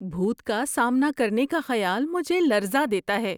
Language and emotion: Urdu, fearful